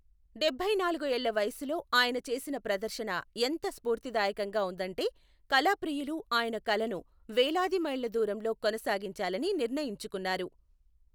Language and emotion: Telugu, neutral